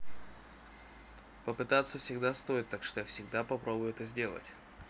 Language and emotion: Russian, neutral